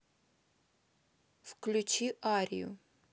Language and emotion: Russian, neutral